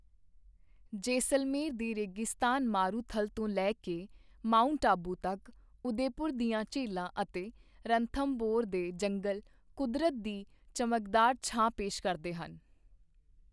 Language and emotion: Punjabi, neutral